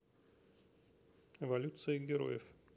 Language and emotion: Russian, neutral